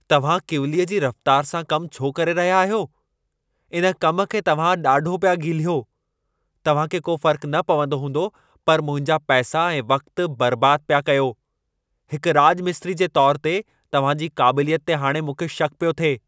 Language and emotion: Sindhi, angry